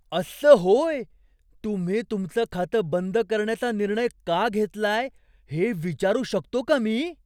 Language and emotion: Marathi, surprised